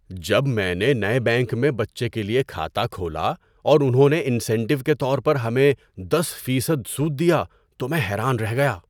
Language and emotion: Urdu, surprised